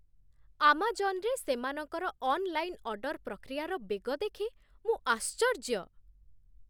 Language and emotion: Odia, surprised